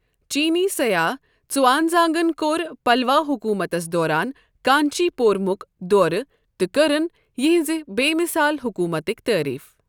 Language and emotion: Kashmiri, neutral